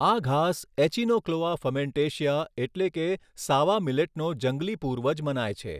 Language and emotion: Gujarati, neutral